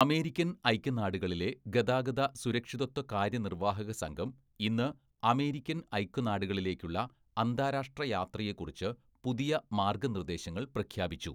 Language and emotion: Malayalam, neutral